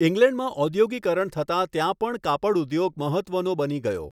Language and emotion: Gujarati, neutral